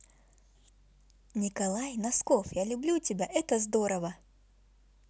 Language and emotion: Russian, positive